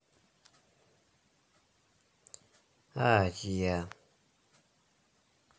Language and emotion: Russian, neutral